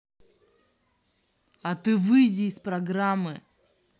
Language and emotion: Russian, angry